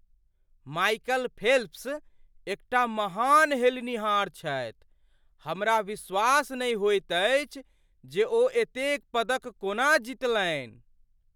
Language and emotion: Maithili, surprised